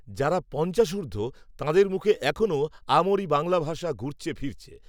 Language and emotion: Bengali, neutral